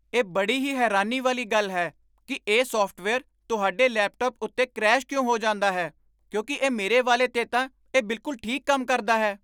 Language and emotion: Punjabi, surprised